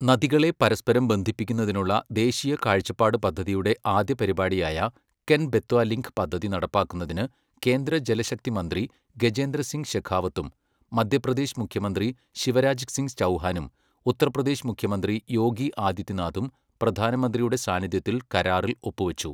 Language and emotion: Malayalam, neutral